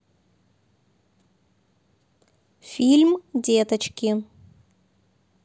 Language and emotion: Russian, neutral